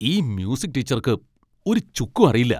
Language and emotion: Malayalam, angry